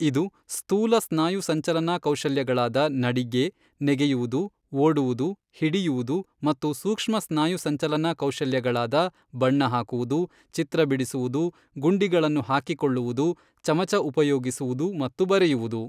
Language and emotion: Kannada, neutral